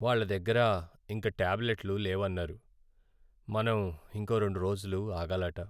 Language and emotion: Telugu, sad